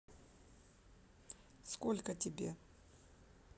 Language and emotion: Russian, neutral